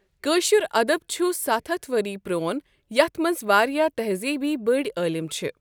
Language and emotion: Kashmiri, neutral